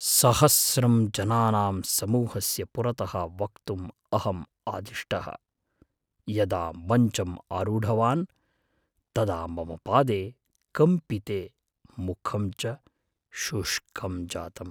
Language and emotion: Sanskrit, fearful